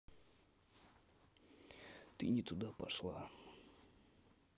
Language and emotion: Russian, neutral